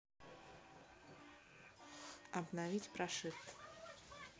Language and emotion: Russian, neutral